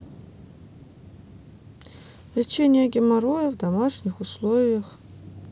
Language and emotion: Russian, neutral